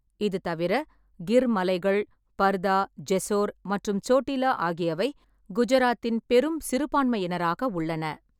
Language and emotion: Tamil, neutral